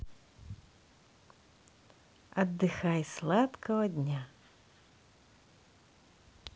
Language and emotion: Russian, positive